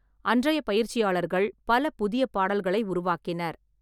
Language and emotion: Tamil, neutral